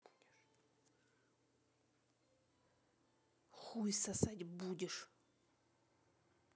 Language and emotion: Russian, angry